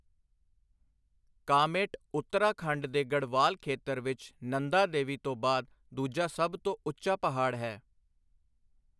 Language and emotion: Punjabi, neutral